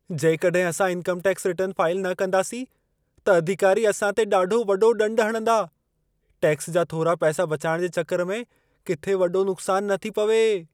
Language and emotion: Sindhi, fearful